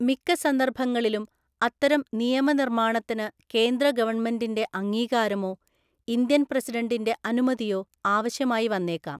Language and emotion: Malayalam, neutral